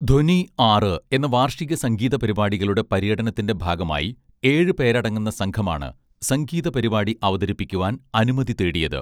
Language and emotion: Malayalam, neutral